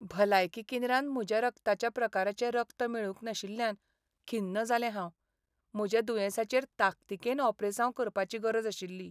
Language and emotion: Goan Konkani, sad